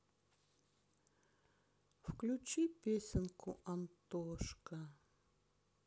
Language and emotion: Russian, sad